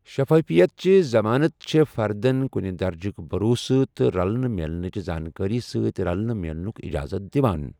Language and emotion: Kashmiri, neutral